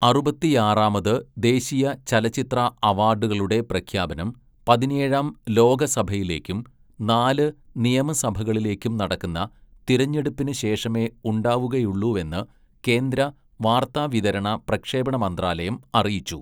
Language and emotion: Malayalam, neutral